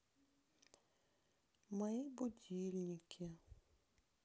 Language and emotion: Russian, sad